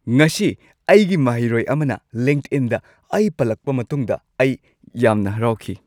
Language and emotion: Manipuri, happy